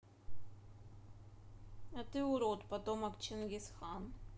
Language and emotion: Russian, neutral